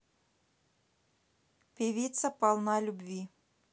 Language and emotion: Russian, neutral